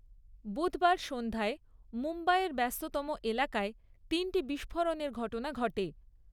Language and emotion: Bengali, neutral